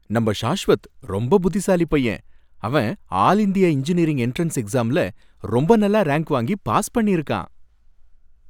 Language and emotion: Tamil, happy